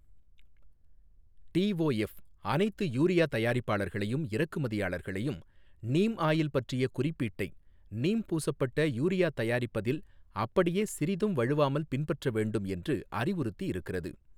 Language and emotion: Tamil, neutral